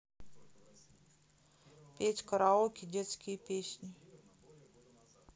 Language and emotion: Russian, neutral